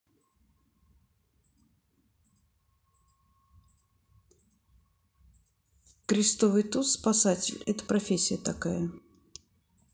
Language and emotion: Russian, neutral